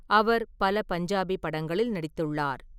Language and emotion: Tamil, neutral